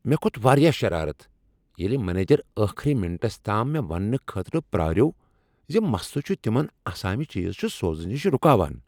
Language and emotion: Kashmiri, angry